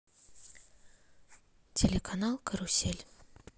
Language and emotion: Russian, neutral